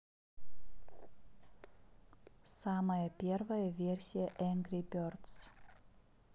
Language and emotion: Russian, neutral